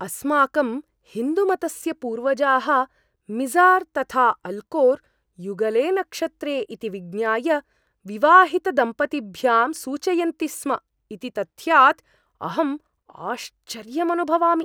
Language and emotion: Sanskrit, surprised